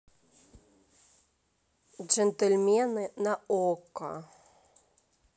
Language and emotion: Russian, neutral